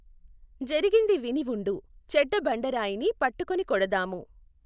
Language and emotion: Telugu, neutral